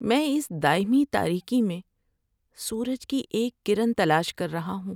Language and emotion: Urdu, sad